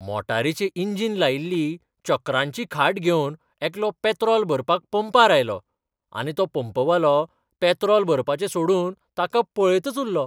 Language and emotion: Goan Konkani, surprised